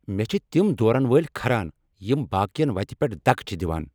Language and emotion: Kashmiri, angry